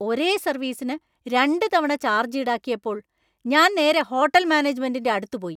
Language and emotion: Malayalam, angry